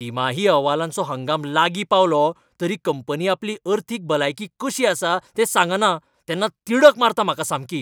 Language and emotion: Goan Konkani, angry